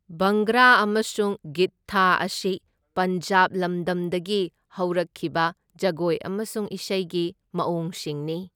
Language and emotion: Manipuri, neutral